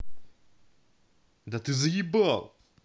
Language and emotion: Russian, angry